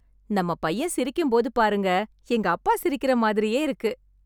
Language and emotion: Tamil, happy